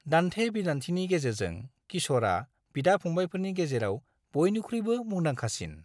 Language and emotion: Bodo, neutral